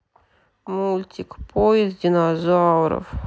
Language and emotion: Russian, sad